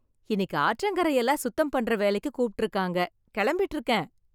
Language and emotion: Tamil, happy